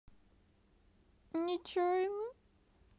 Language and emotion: Russian, sad